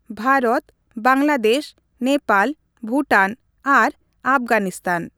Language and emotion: Santali, neutral